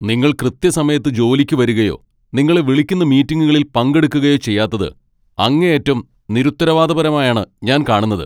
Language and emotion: Malayalam, angry